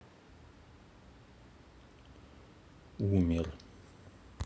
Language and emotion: Russian, sad